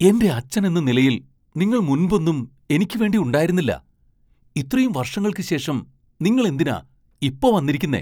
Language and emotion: Malayalam, surprised